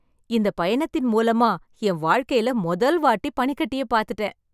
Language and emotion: Tamil, happy